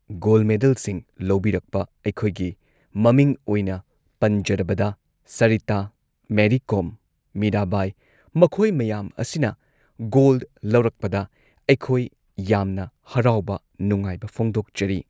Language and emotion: Manipuri, neutral